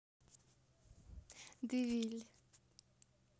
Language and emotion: Russian, neutral